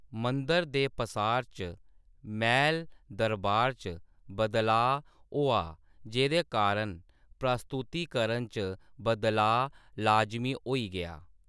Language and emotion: Dogri, neutral